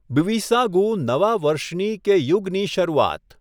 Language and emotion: Gujarati, neutral